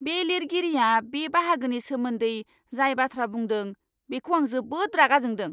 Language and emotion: Bodo, angry